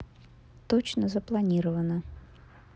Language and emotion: Russian, neutral